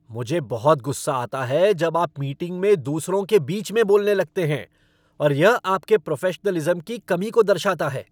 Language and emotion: Hindi, angry